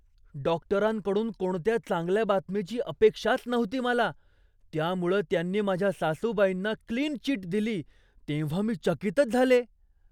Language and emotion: Marathi, surprised